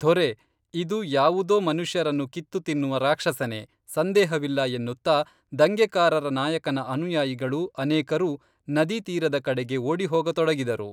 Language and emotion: Kannada, neutral